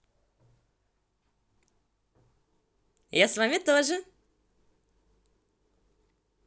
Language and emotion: Russian, positive